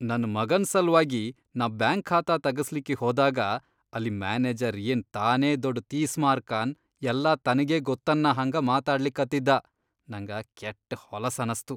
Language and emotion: Kannada, disgusted